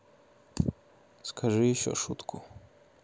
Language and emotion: Russian, neutral